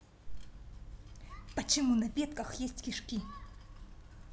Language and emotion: Russian, angry